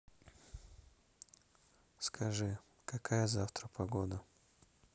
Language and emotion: Russian, neutral